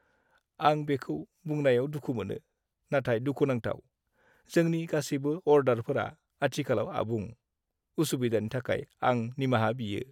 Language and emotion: Bodo, sad